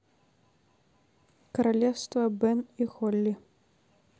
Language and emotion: Russian, neutral